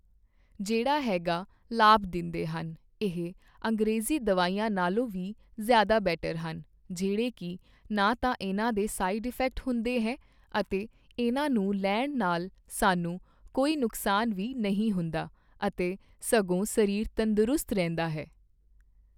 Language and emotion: Punjabi, neutral